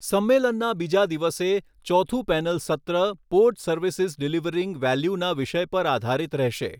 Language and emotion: Gujarati, neutral